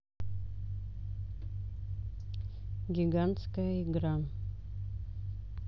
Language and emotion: Russian, neutral